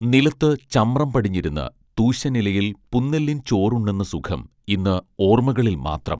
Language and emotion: Malayalam, neutral